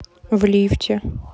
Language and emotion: Russian, neutral